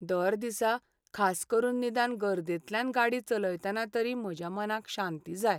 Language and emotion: Goan Konkani, sad